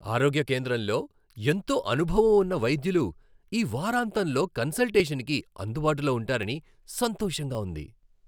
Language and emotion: Telugu, happy